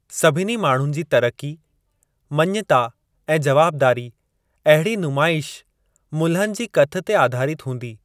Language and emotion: Sindhi, neutral